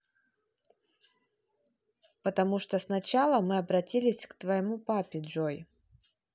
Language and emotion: Russian, neutral